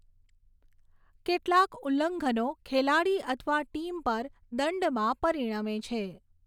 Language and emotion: Gujarati, neutral